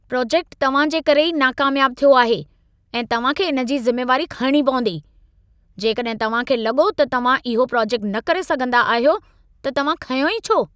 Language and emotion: Sindhi, angry